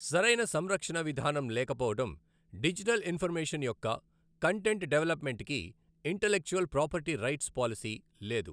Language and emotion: Telugu, neutral